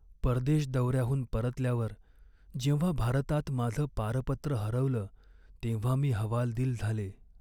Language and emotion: Marathi, sad